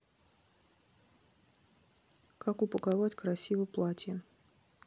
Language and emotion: Russian, neutral